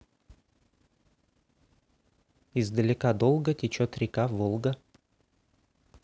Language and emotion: Russian, neutral